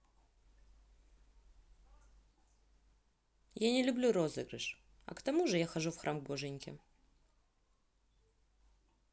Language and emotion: Russian, neutral